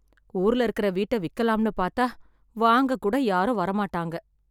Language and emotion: Tamil, sad